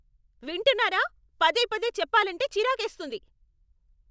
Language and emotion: Telugu, angry